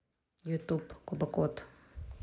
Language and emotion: Russian, neutral